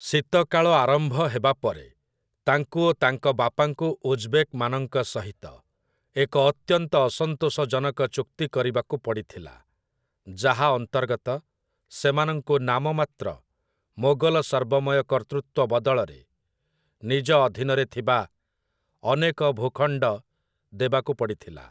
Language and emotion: Odia, neutral